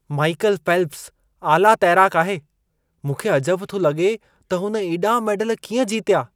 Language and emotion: Sindhi, surprised